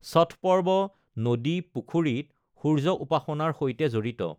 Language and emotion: Assamese, neutral